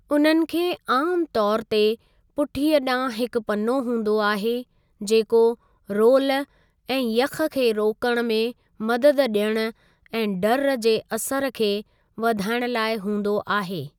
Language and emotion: Sindhi, neutral